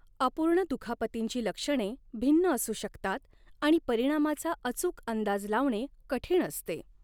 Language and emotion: Marathi, neutral